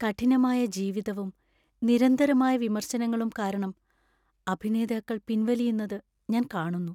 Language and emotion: Malayalam, sad